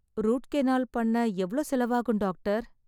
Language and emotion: Tamil, sad